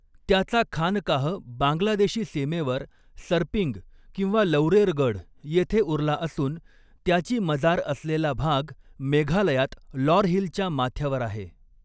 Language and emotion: Marathi, neutral